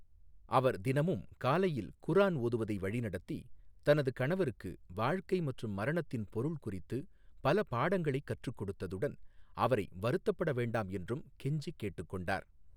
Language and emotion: Tamil, neutral